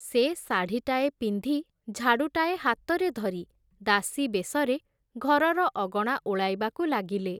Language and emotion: Odia, neutral